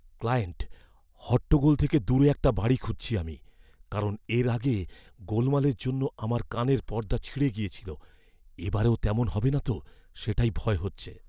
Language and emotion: Bengali, fearful